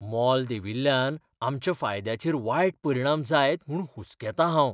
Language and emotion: Goan Konkani, fearful